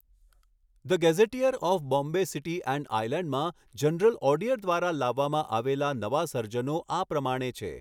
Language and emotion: Gujarati, neutral